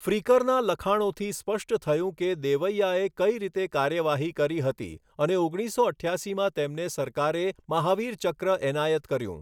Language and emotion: Gujarati, neutral